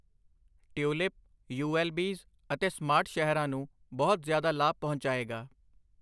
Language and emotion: Punjabi, neutral